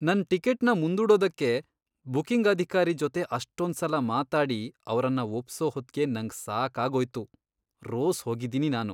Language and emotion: Kannada, disgusted